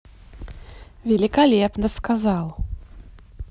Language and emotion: Russian, positive